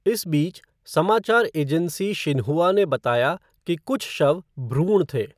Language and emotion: Hindi, neutral